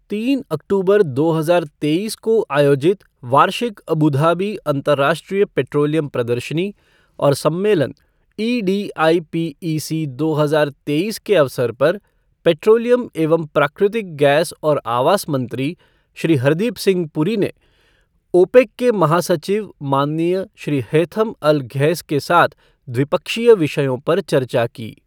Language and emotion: Hindi, neutral